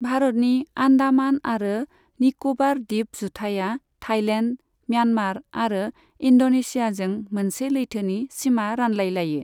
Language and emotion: Bodo, neutral